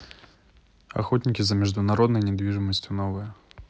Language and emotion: Russian, neutral